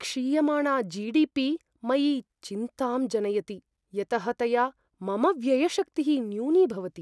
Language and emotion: Sanskrit, fearful